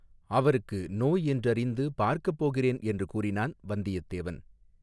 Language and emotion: Tamil, neutral